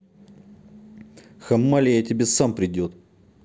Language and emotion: Russian, angry